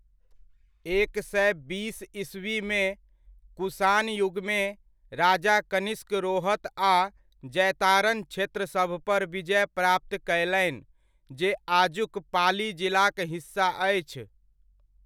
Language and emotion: Maithili, neutral